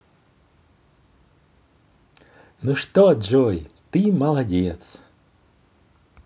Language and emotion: Russian, positive